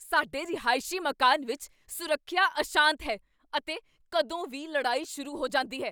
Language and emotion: Punjabi, angry